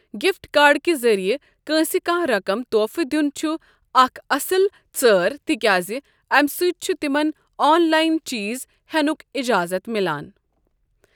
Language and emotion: Kashmiri, neutral